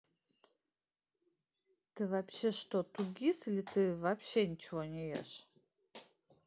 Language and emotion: Russian, neutral